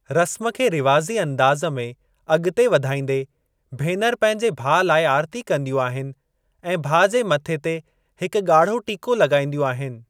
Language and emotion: Sindhi, neutral